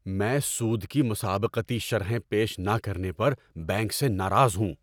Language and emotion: Urdu, angry